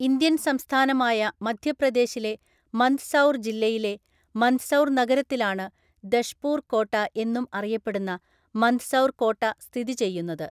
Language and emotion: Malayalam, neutral